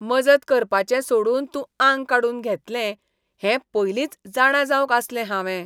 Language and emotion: Goan Konkani, disgusted